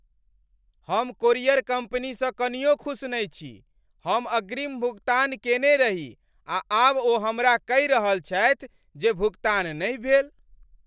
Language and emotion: Maithili, angry